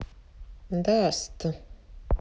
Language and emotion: Russian, neutral